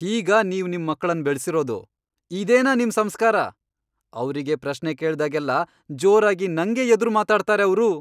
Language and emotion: Kannada, angry